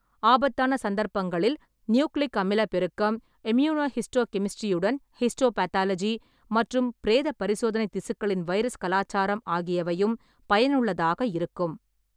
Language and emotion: Tamil, neutral